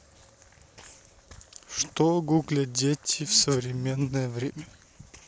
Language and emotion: Russian, neutral